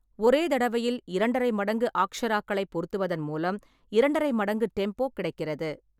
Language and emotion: Tamil, neutral